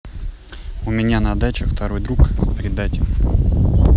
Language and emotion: Russian, neutral